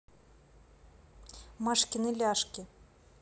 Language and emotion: Russian, neutral